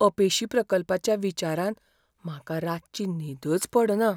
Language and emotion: Goan Konkani, fearful